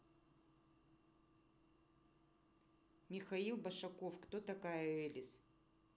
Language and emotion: Russian, neutral